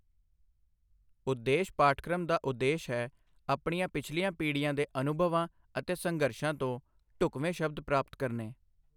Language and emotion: Punjabi, neutral